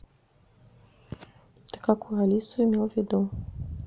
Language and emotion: Russian, neutral